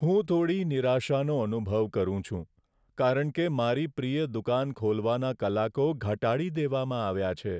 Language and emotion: Gujarati, sad